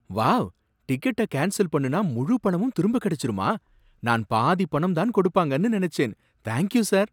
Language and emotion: Tamil, surprised